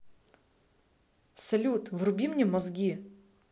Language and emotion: Russian, positive